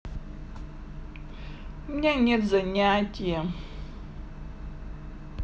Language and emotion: Russian, sad